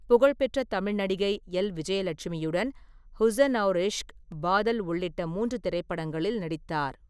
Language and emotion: Tamil, neutral